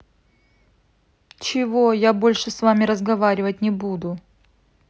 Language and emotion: Russian, angry